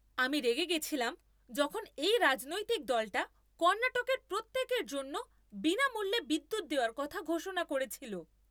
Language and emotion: Bengali, angry